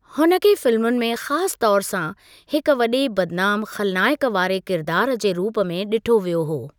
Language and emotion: Sindhi, neutral